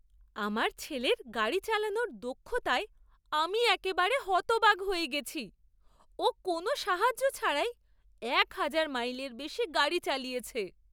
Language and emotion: Bengali, surprised